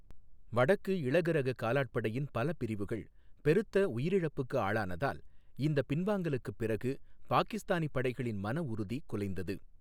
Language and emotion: Tamil, neutral